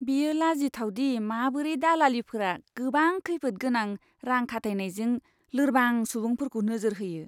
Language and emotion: Bodo, disgusted